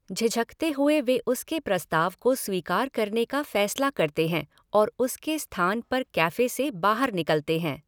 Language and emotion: Hindi, neutral